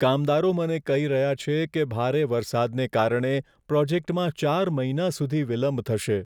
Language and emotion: Gujarati, sad